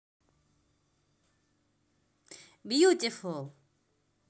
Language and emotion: Russian, positive